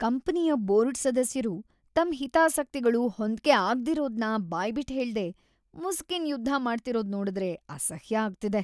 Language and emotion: Kannada, disgusted